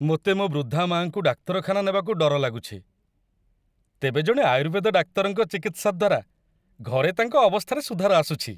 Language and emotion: Odia, happy